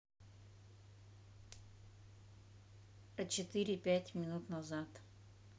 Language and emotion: Russian, neutral